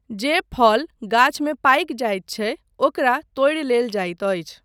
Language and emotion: Maithili, neutral